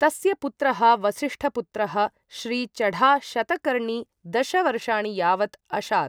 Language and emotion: Sanskrit, neutral